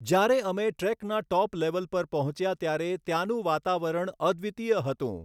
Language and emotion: Gujarati, neutral